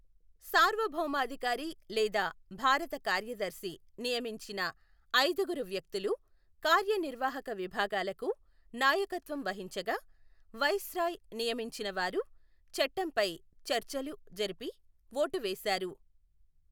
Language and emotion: Telugu, neutral